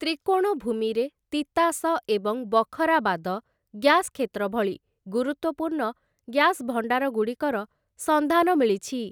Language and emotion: Odia, neutral